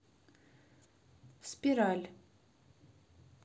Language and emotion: Russian, neutral